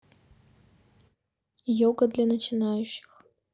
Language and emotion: Russian, neutral